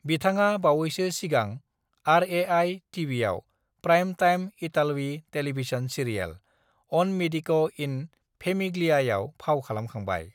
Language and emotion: Bodo, neutral